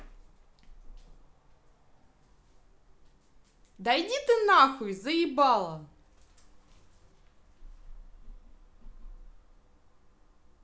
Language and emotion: Russian, angry